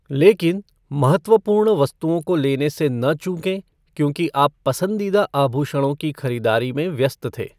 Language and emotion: Hindi, neutral